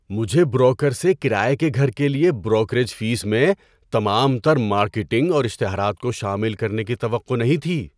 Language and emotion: Urdu, surprised